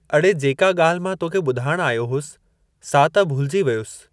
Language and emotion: Sindhi, neutral